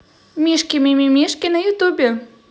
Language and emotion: Russian, positive